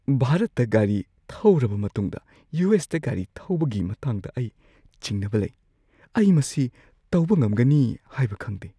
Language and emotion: Manipuri, fearful